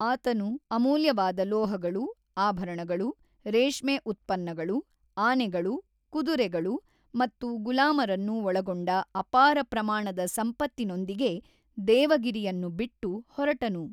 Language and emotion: Kannada, neutral